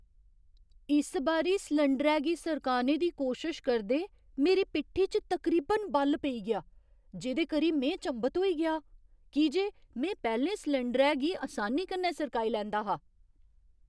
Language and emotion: Dogri, surprised